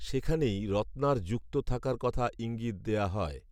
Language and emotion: Bengali, neutral